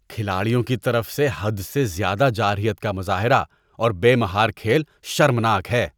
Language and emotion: Urdu, disgusted